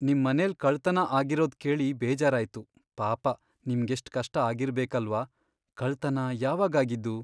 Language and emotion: Kannada, sad